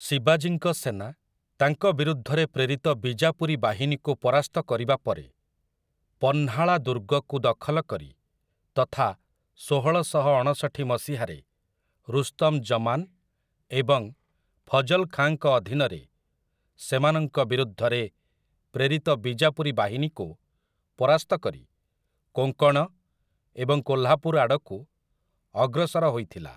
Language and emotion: Odia, neutral